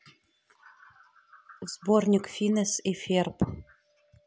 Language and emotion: Russian, neutral